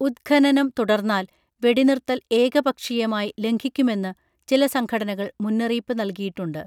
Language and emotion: Malayalam, neutral